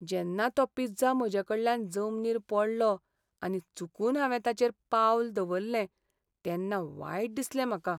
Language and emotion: Goan Konkani, sad